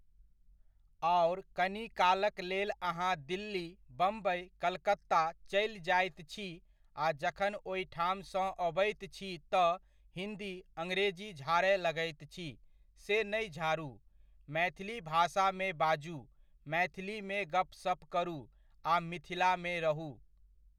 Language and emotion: Maithili, neutral